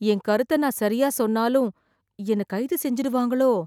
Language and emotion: Tamil, fearful